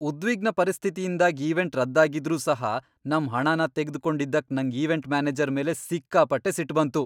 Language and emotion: Kannada, angry